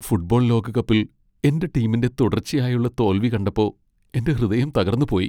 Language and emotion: Malayalam, sad